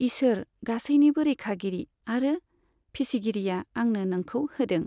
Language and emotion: Bodo, neutral